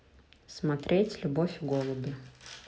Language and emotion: Russian, neutral